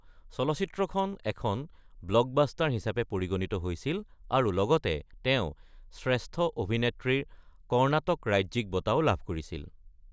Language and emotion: Assamese, neutral